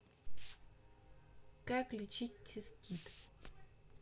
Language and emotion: Russian, neutral